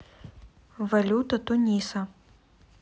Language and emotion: Russian, neutral